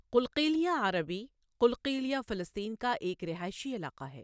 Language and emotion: Urdu, neutral